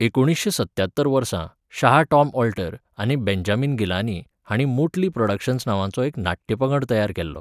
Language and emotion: Goan Konkani, neutral